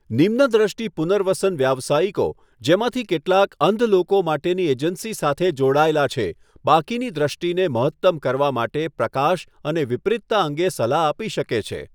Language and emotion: Gujarati, neutral